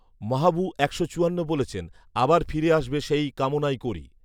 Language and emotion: Bengali, neutral